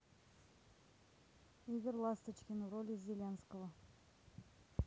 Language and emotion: Russian, neutral